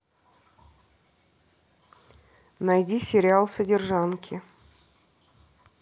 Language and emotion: Russian, neutral